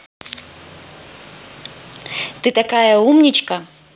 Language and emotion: Russian, positive